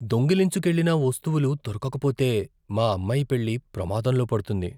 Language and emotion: Telugu, fearful